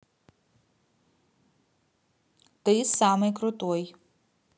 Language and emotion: Russian, positive